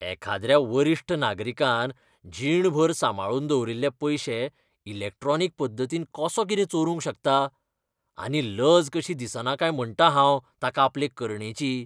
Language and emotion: Goan Konkani, disgusted